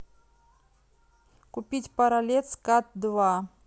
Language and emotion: Russian, neutral